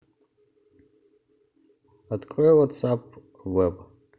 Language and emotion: Russian, neutral